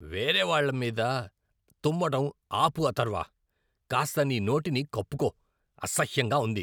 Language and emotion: Telugu, disgusted